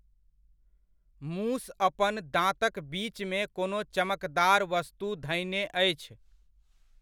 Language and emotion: Maithili, neutral